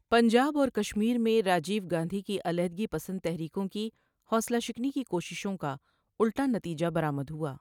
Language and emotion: Urdu, neutral